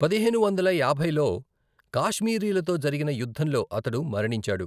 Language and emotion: Telugu, neutral